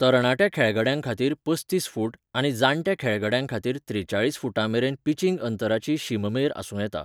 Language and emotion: Goan Konkani, neutral